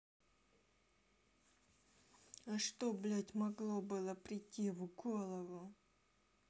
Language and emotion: Russian, angry